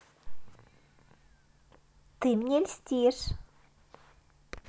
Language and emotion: Russian, positive